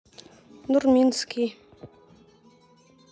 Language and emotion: Russian, neutral